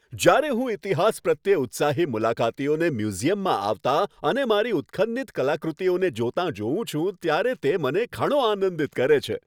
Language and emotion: Gujarati, happy